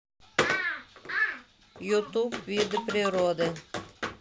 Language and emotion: Russian, neutral